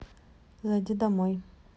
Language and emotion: Russian, neutral